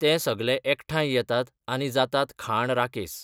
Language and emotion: Goan Konkani, neutral